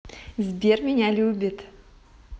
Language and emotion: Russian, positive